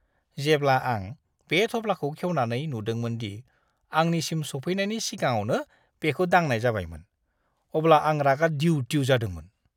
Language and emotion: Bodo, disgusted